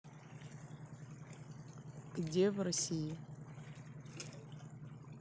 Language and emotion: Russian, neutral